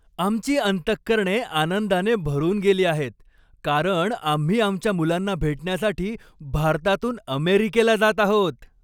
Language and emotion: Marathi, happy